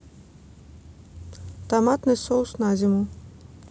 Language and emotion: Russian, neutral